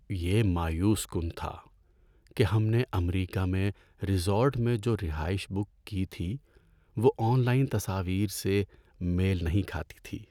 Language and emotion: Urdu, sad